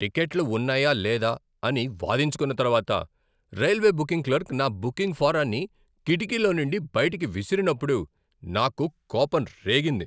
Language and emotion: Telugu, angry